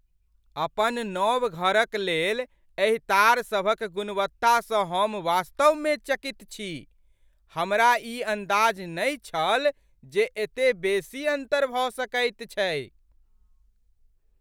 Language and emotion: Maithili, surprised